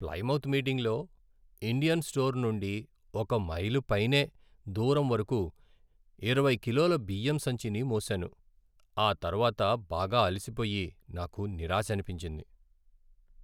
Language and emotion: Telugu, sad